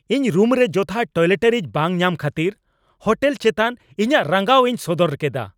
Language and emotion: Santali, angry